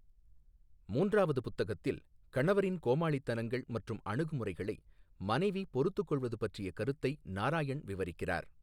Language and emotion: Tamil, neutral